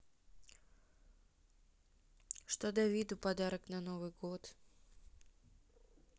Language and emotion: Russian, sad